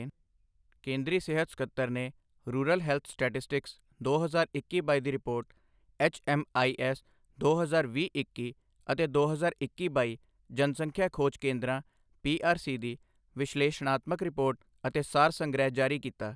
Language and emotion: Punjabi, neutral